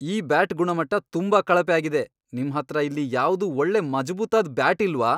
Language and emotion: Kannada, angry